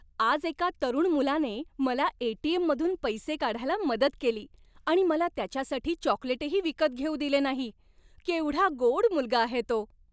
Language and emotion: Marathi, happy